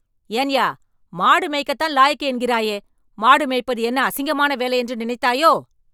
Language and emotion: Tamil, angry